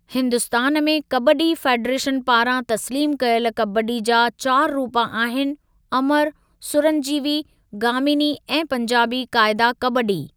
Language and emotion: Sindhi, neutral